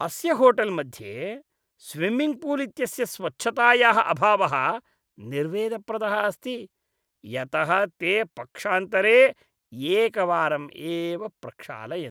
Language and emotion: Sanskrit, disgusted